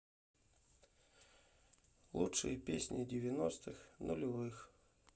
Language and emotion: Russian, sad